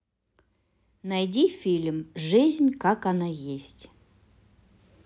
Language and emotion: Russian, positive